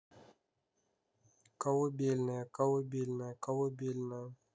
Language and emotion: Russian, neutral